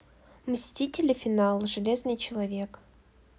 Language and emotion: Russian, neutral